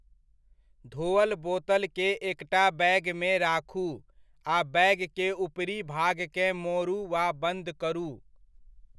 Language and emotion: Maithili, neutral